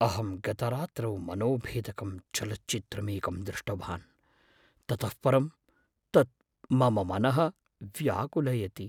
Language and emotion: Sanskrit, fearful